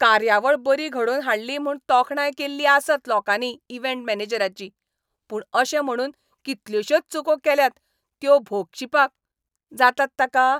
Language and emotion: Goan Konkani, angry